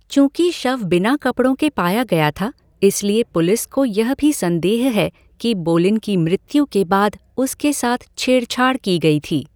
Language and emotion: Hindi, neutral